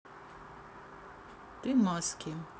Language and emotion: Russian, neutral